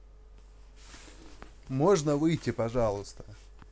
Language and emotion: Russian, neutral